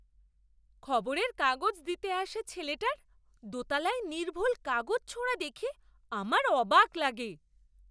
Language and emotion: Bengali, surprised